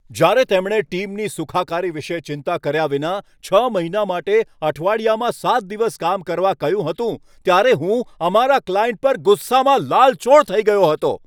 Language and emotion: Gujarati, angry